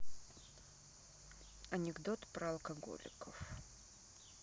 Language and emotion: Russian, neutral